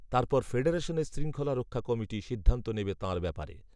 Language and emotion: Bengali, neutral